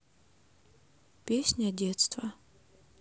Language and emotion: Russian, neutral